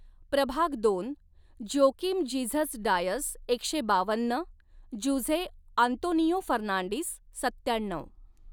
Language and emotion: Marathi, neutral